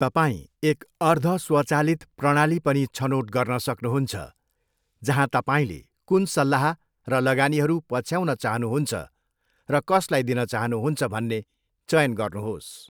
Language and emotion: Nepali, neutral